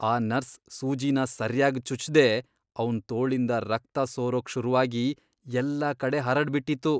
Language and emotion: Kannada, disgusted